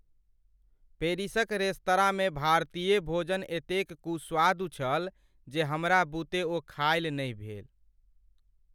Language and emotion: Maithili, sad